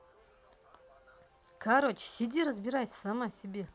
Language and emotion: Russian, angry